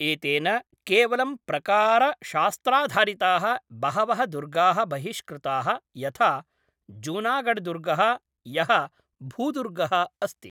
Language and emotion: Sanskrit, neutral